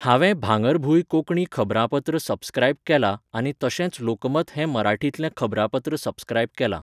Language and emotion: Goan Konkani, neutral